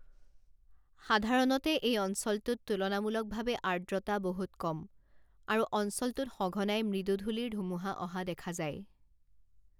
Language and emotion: Assamese, neutral